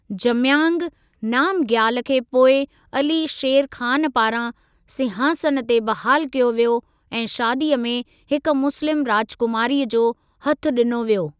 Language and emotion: Sindhi, neutral